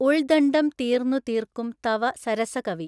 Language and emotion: Malayalam, neutral